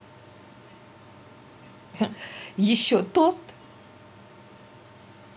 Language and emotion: Russian, positive